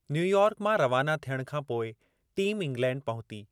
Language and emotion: Sindhi, neutral